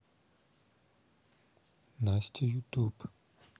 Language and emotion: Russian, neutral